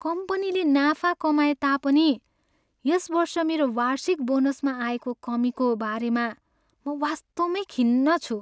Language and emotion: Nepali, sad